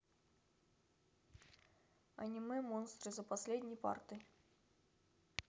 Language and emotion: Russian, neutral